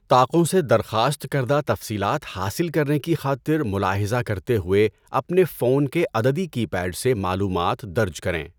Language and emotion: Urdu, neutral